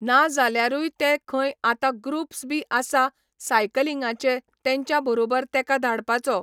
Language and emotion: Goan Konkani, neutral